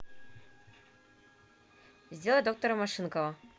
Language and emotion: Russian, neutral